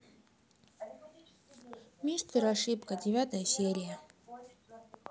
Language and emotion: Russian, sad